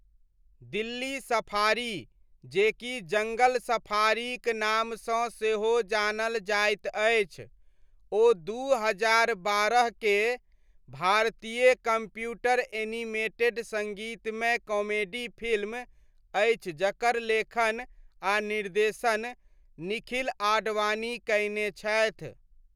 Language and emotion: Maithili, neutral